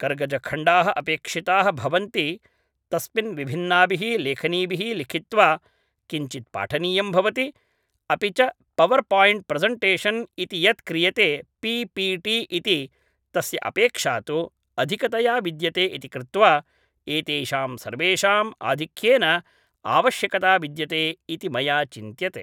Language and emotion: Sanskrit, neutral